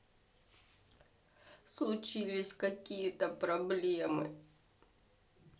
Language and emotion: Russian, sad